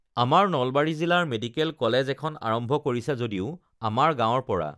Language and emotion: Assamese, neutral